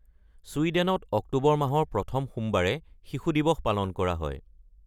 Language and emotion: Assamese, neutral